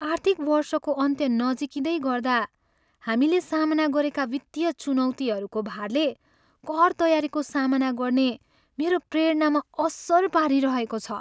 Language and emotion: Nepali, sad